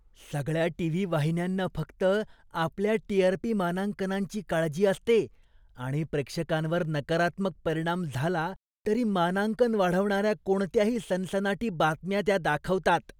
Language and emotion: Marathi, disgusted